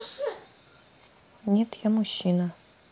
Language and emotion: Russian, neutral